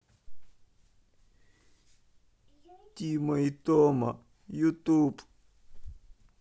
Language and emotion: Russian, sad